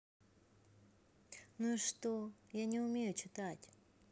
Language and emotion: Russian, neutral